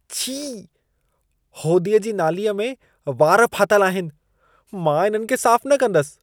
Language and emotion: Sindhi, disgusted